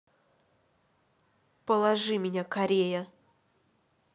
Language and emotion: Russian, angry